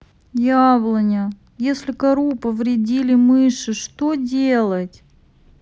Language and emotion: Russian, sad